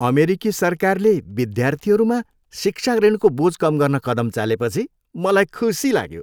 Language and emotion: Nepali, happy